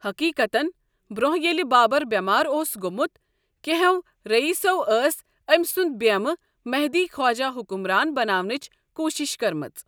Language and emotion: Kashmiri, neutral